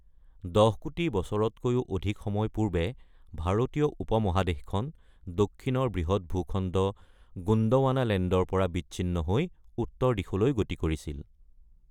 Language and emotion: Assamese, neutral